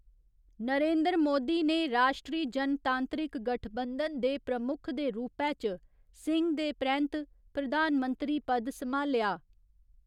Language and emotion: Dogri, neutral